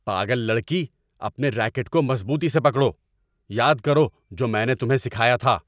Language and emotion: Urdu, angry